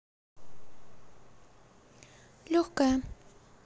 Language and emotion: Russian, neutral